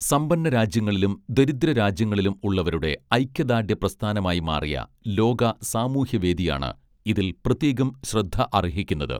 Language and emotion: Malayalam, neutral